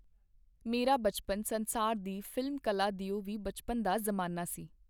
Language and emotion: Punjabi, neutral